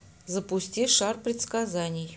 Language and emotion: Russian, neutral